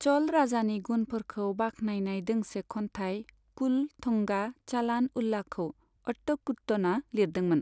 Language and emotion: Bodo, neutral